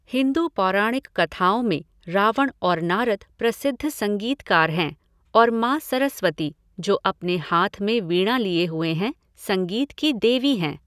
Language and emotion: Hindi, neutral